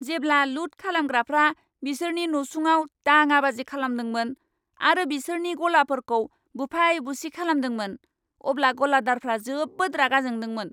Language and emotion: Bodo, angry